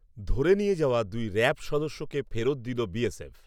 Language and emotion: Bengali, neutral